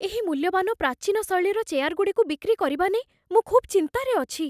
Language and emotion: Odia, fearful